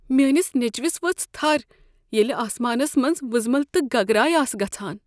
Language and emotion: Kashmiri, fearful